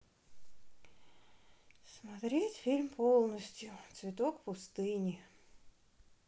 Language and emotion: Russian, sad